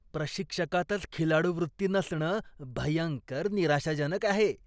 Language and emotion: Marathi, disgusted